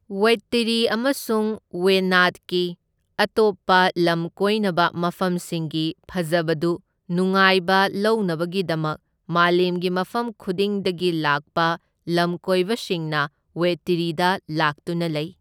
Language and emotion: Manipuri, neutral